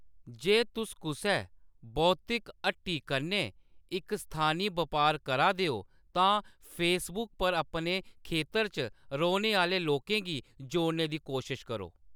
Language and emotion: Dogri, neutral